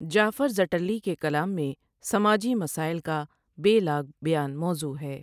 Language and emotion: Urdu, neutral